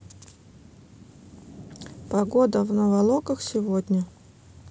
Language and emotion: Russian, neutral